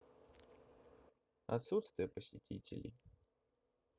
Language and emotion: Russian, neutral